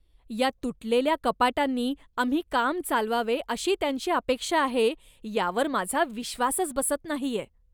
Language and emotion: Marathi, disgusted